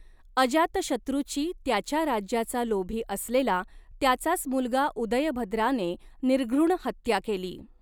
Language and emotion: Marathi, neutral